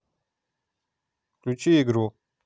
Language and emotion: Russian, neutral